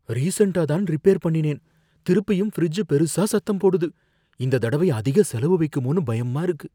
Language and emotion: Tamil, fearful